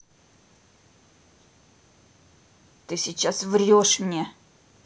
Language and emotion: Russian, angry